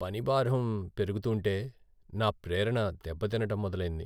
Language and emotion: Telugu, sad